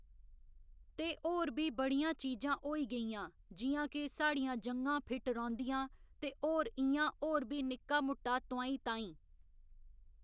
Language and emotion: Dogri, neutral